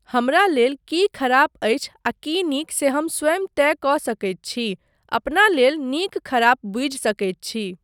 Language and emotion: Maithili, neutral